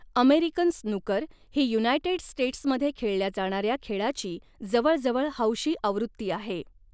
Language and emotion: Marathi, neutral